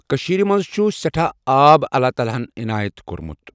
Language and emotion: Kashmiri, neutral